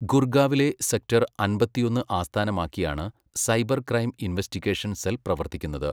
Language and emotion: Malayalam, neutral